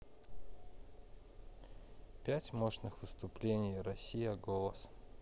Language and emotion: Russian, sad